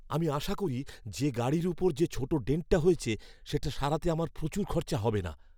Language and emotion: Bengali, fearful